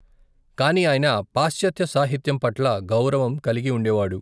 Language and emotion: Telugu, neutral